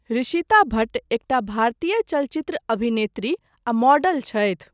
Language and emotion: Maithili, neutral